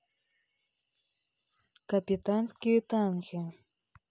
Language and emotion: Russian, neutral